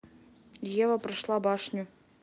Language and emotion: Russian, neutral